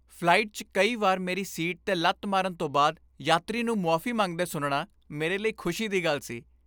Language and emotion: Punjabi, happy